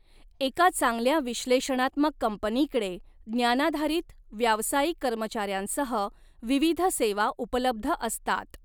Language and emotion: Marathi, neutral